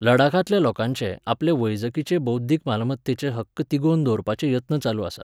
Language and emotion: Goan Konkani, neutral